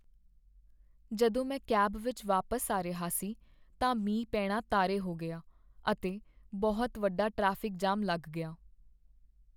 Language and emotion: Punjabi, sad